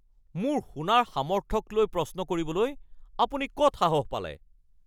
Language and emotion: Assamese, angry